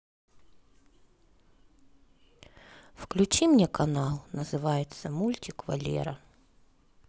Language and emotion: Russian, sad